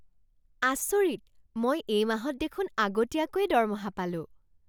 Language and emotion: Assamese, surprised